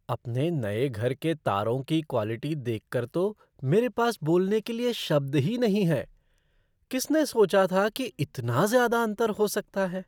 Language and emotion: Hindi, surprised